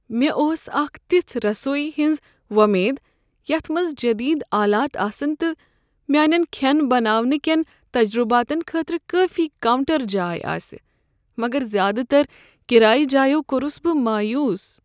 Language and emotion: Kashmiri, sad